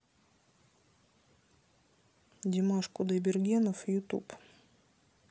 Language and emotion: Russian, neutral